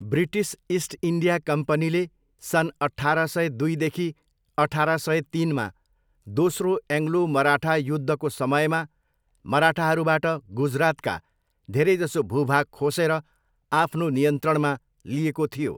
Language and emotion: Nepali, neutral